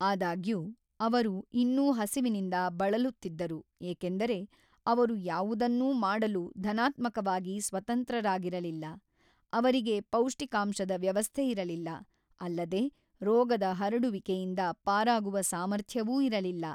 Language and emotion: Kannada, neutral